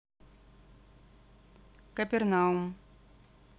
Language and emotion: Russian, neutral